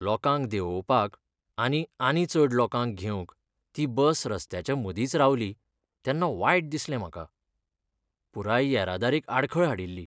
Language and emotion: Goan Konkani, sad